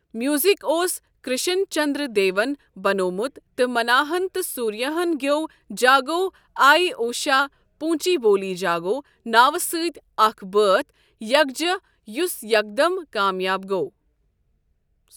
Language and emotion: Kashmiri, neutral